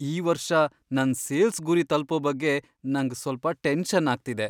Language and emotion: Kannada, fearful